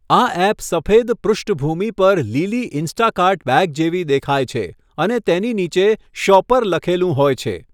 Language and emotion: Gujarati, neutral